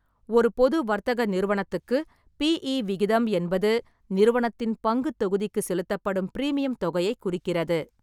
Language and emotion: Tamil, neutral